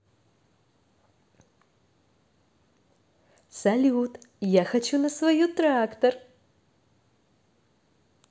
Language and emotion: Russian, positive